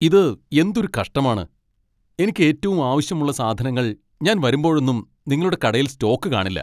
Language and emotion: Malayalam, angry